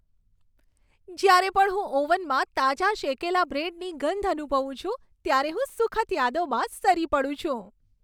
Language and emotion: Gujarati, happy